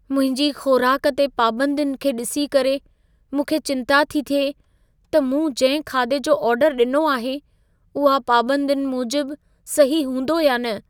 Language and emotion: Sindhi, fearful